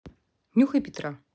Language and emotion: Russian, neutral